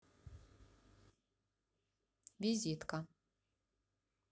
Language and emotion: Russian, neutral